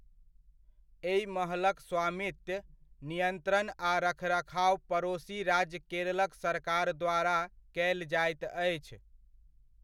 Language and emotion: Maithili, neutral